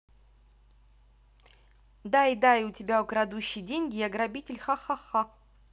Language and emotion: Russian, neutral